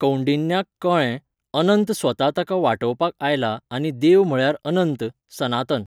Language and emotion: Goan Konkani, neutral